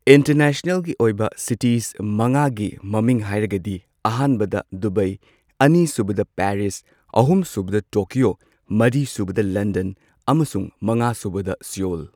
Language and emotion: Manipuri, neutral